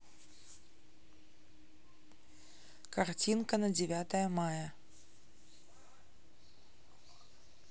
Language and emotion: Russian, neutral